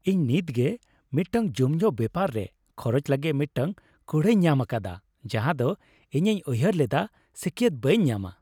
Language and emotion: Santali, happy